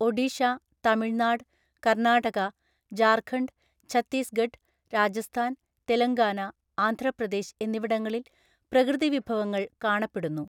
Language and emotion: Malayalam, neutral